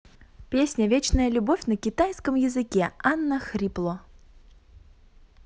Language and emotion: Russian, positive